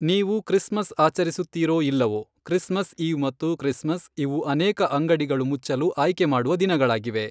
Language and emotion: Kannada, neutral